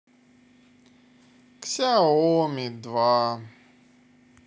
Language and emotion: Russian, sad